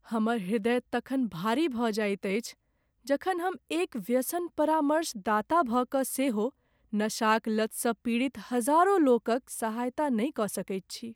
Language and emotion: Maithili, sad